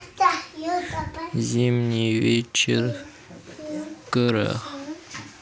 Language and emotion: Russian, neutral